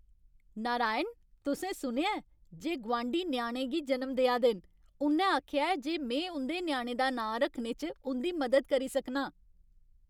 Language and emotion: Dogri, happy